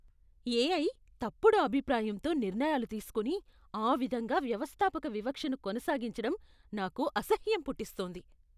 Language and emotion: Telugu, disgusted